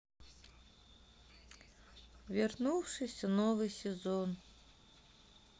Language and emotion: Russian, sad